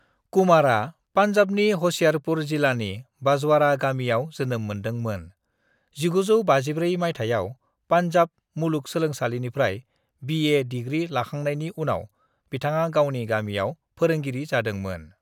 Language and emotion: Bodo, neutral